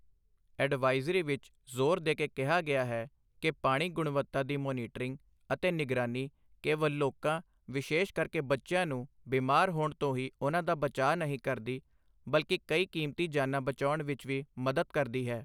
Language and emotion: Punjabi, neutral